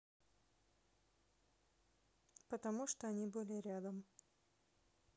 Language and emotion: Russian, neutral